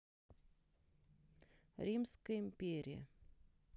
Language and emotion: Russian, neutral